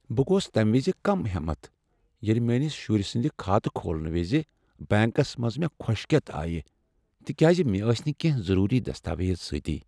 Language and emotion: Kashmiri, sad